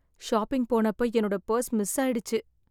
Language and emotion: Tamil, sad